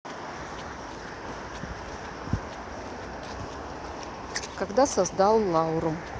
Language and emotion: Russian, neutral